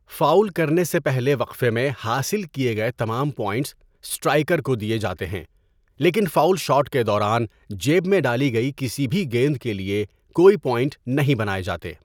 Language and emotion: Urdu, neutral